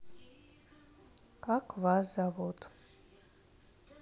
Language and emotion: Russian, neutral